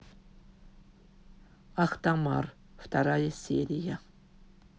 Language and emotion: Russian, neutral